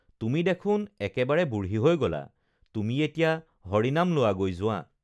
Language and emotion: Assamese, neutral